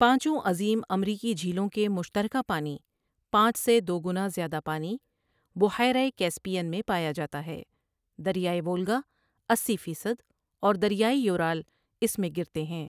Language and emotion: Urdu, neutral